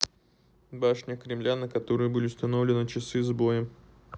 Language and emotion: Russian, neutral